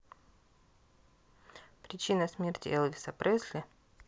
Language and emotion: Russian, neutral